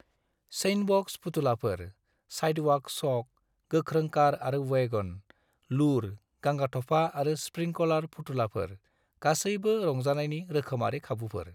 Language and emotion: Bodo, neutral